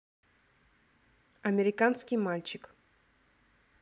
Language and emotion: Russian, neutral